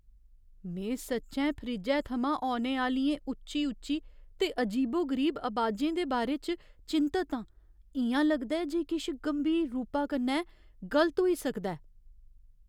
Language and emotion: Dogri, fearful